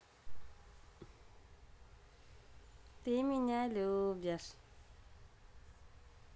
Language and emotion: Russian, positive